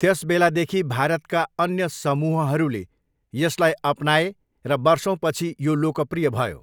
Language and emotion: Nepali, neutral